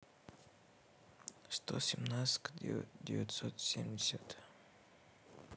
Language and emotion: Russian, neutral